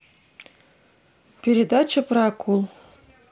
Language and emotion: Russian, neutral